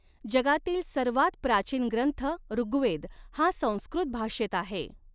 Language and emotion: Marathi, neutral